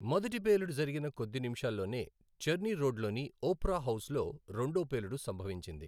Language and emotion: Telugu, neutral